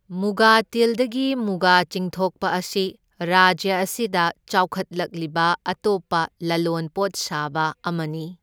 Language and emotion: Manipuri, neutral